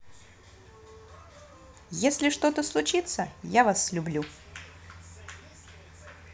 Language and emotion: Russian, positive